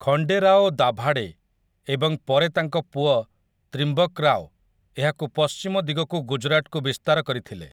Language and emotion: Odia, neutral